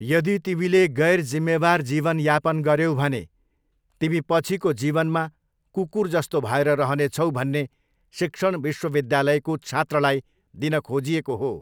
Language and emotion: Nepali, neutral